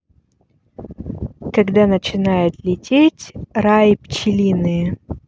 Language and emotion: Russian, neutral